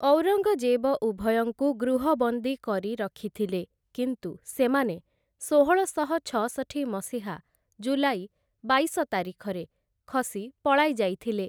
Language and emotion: Odia, neutral